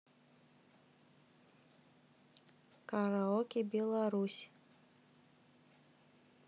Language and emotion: Russian, neutral